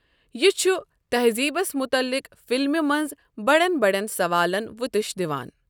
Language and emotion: Kashmiri, neutral